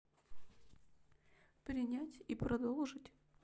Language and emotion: Russian, sad